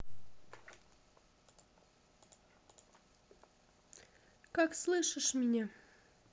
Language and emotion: Russian, neutral